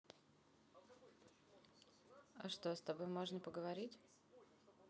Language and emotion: Russian, neutral